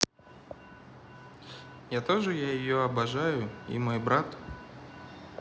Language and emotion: Russian, neutral